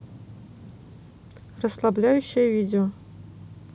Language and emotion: Russian, neutral